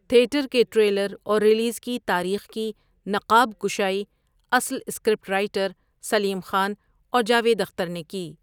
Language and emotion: Urdu, neutral